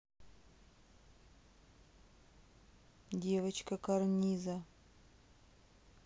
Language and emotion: Russian, neutral